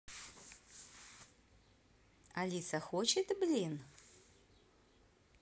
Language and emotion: Russian, positive